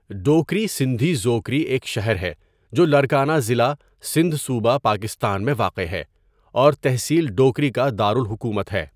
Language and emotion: Urdu, neutral